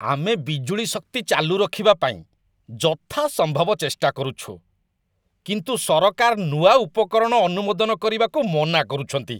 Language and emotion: Odia, disgusted